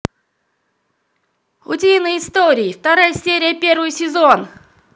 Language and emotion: Russian, positive